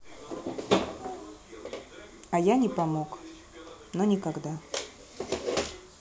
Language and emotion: Russian, neutral